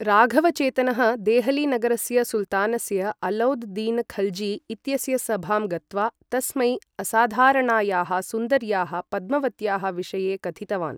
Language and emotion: Sanskrit, neutral